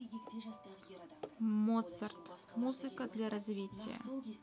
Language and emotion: Russian, neutral